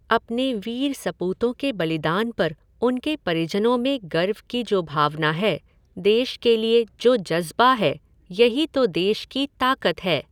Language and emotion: Hindi, neutral